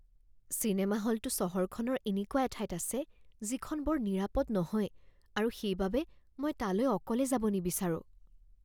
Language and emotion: Assamese, fearful